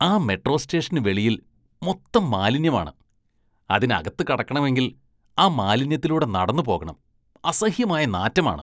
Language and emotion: Malayalam, disgusted